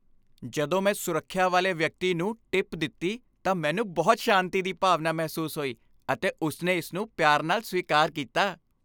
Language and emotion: Punjabi, happy